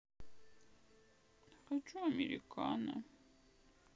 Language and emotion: Russian, sad